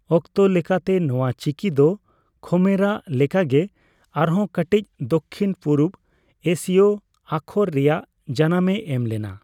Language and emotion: Santali, neutral